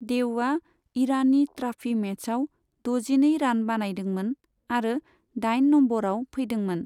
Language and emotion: Bodo, neutral